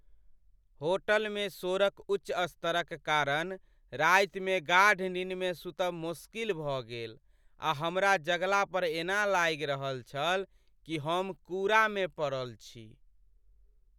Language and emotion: Maithili, sad